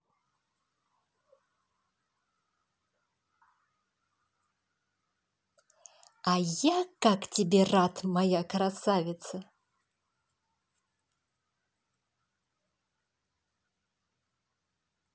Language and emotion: Russian, positive